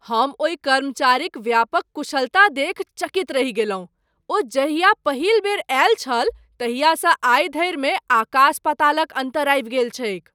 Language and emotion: Maithili, surprised